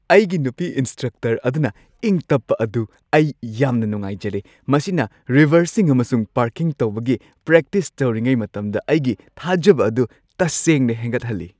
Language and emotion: Manipuri, happy